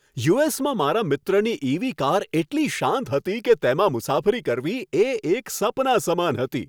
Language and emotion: Gujarati, happy